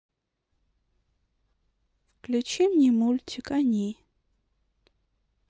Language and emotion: Russian, neutral